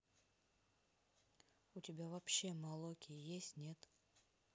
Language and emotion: Russian, neutral